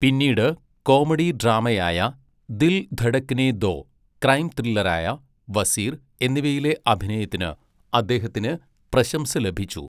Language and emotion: Malayalam, neutral